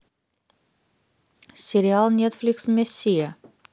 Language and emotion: Russian, neutral